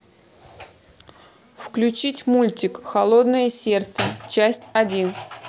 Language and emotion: Russian, neutral